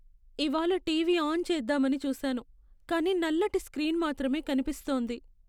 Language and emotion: Telugu, sad